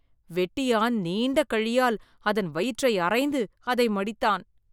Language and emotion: Tamil, disgusted